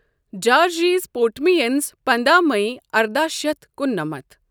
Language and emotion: Kashmiri, neutral